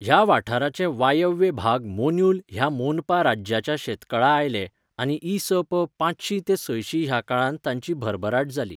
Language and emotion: Goan Konkani, neutral